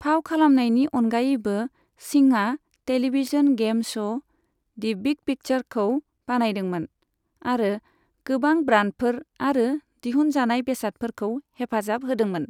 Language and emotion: Bodo, neutral